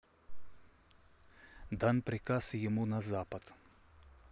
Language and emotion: Russian, neutral